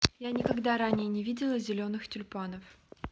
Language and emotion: Russian, neutral